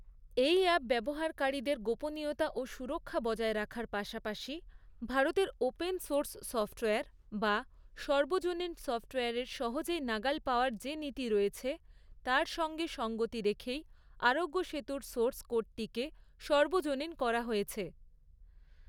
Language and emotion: Bengali, neutral